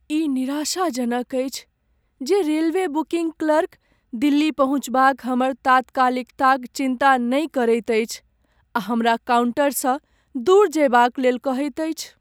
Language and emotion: Maithili, sad